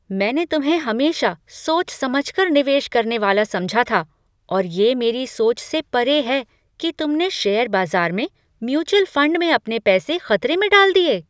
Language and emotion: Hindi, surprised